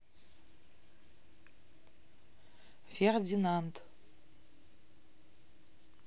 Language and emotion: Russian, neutral